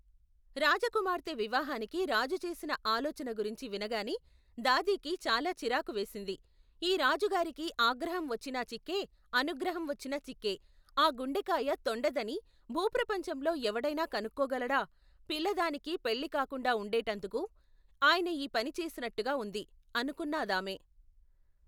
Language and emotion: Telugu, neutral